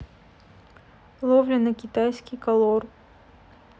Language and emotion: Russian, neutral